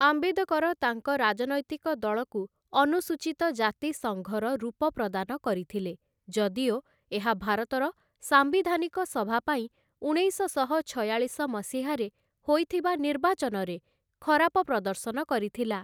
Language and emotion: Odia, neutral